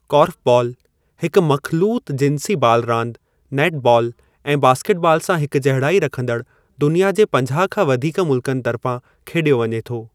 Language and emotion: Sindhi, neutral